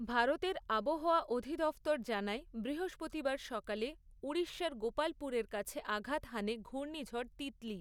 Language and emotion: Bengali, neutral